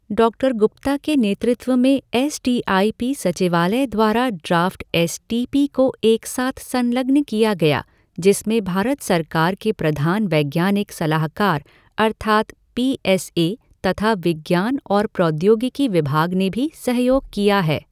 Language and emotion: Hindi, neutral